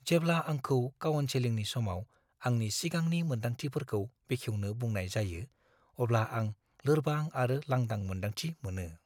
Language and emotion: Bodo, fearful